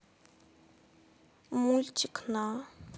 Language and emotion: Russian, sad